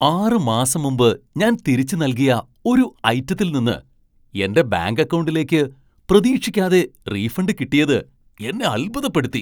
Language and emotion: Malayalam, surprised